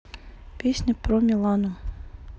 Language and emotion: Russian, neutral